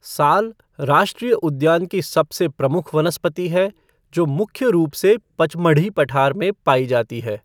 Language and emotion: Hindi, neutral